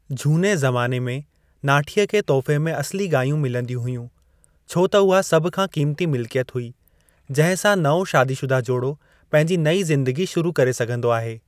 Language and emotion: Sindhi, neutral